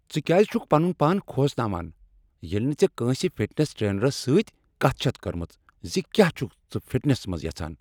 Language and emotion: Kashmiri, angry